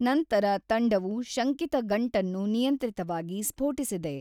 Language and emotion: Kannada, neutral